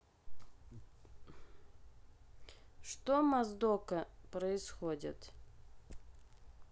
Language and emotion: Russian, neutral